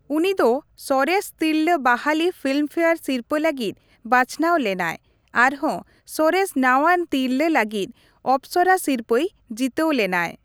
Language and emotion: Santali, neutral